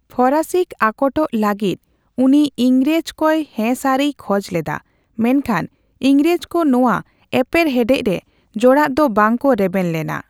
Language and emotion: Santali, neutral